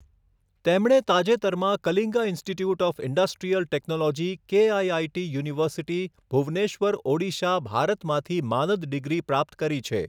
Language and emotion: Gujarati, neutral